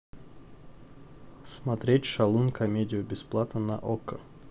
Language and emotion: Russian, neutral